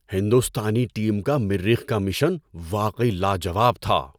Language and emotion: Urdu, surprised